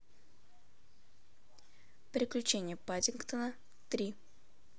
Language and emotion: Russian, neutral